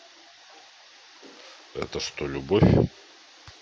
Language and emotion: Russian, neutral